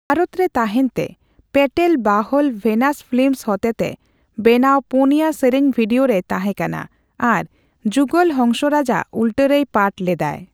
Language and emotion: Santali, neutral